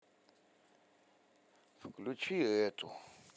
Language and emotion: Russian, sad